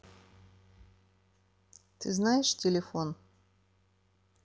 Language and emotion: Russian, neutral